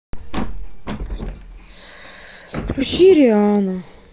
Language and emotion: Russian, sad